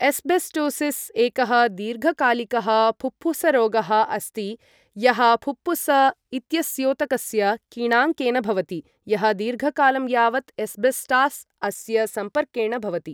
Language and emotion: Sanskrit, neutral